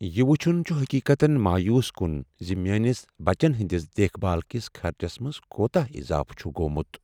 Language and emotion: Kashmiri, sad